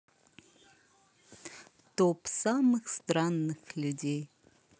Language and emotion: Russian, positive